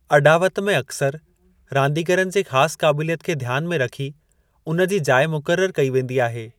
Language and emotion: Sindhi, neutral